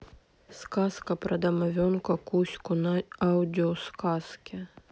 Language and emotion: Russian, sad